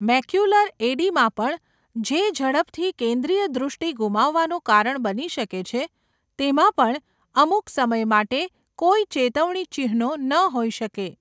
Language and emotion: Gujarati, neutral